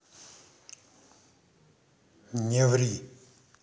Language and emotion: Russian, angry